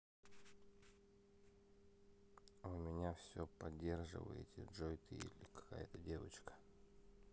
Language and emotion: Russian, neutral